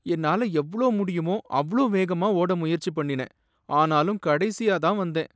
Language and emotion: Tamil, sad